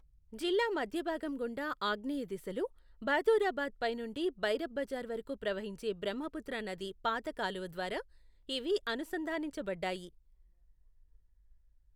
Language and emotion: Telugu, neutral